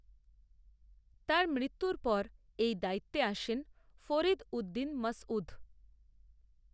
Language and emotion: Bengali, neutral